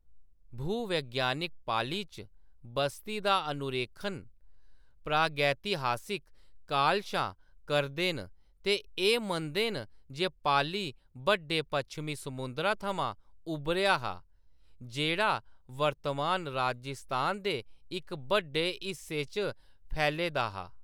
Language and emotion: Dogri, neutral